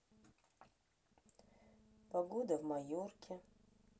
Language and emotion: Russian, sad